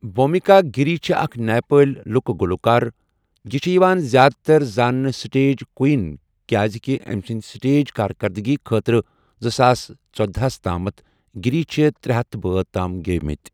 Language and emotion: Kashmiri, neutral